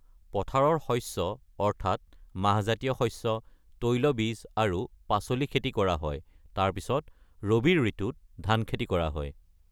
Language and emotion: Assamese, neutral